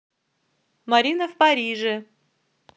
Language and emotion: Russian, neutral